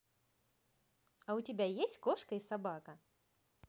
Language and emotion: Russian, positive